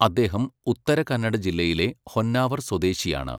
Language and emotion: Malayalam, neutral